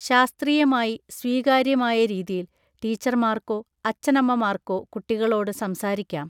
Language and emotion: Malayalam, neutral